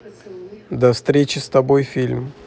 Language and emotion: Russian, neutral